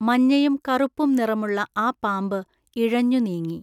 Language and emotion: Malayalam, neutral